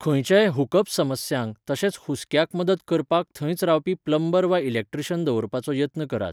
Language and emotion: Goan Konkani, neutral